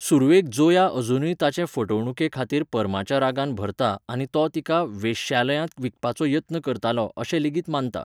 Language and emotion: Goan Konkani, neutral